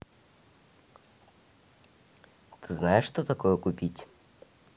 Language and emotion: Russian, neutral